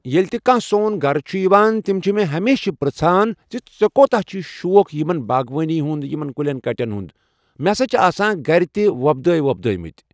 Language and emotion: Kashmiri, neutral